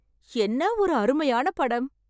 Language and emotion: Tamil, happy